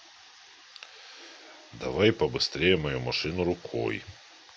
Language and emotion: Russian, neutral